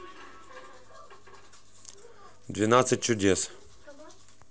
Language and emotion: Russian, neutral